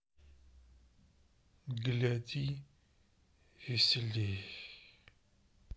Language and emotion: Russian, sad